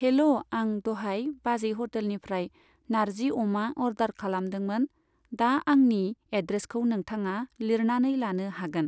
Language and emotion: Bodo, neutral